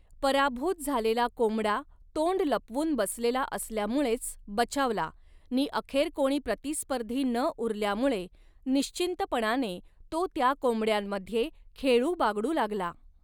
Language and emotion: Marathi, neutral